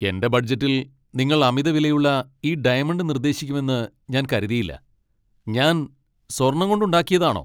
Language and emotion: Malayalam, angry